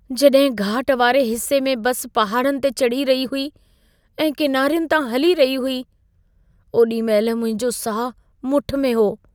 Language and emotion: Sindhi, fearful